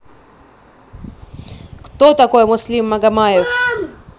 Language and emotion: Russian, angry